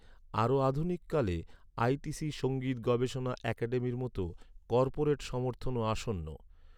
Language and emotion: Bengali, neutral